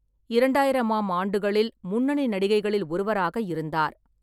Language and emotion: Tamil, neutral